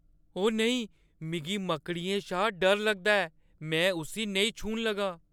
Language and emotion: Dogri, fearful